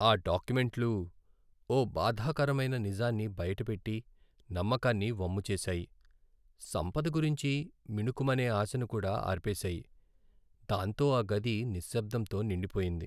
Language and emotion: Telugu, sad